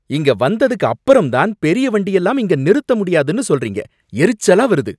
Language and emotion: Tamil, angry